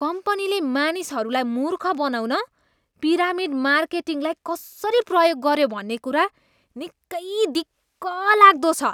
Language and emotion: Nepali, disgusted